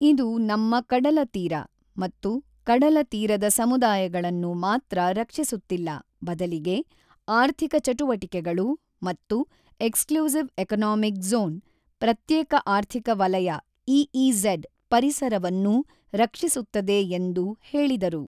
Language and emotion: Kannada, neutral